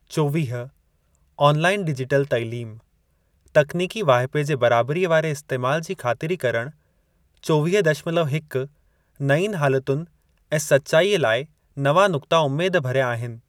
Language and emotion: Sindhi, neutral